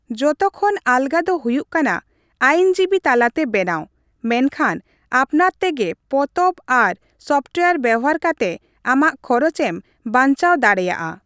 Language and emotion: Santali, neutral